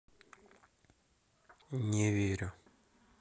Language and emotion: Russian, neutral